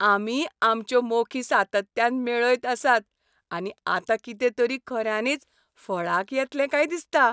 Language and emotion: Goan Konkani, happy